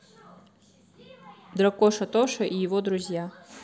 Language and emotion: Russian, neutral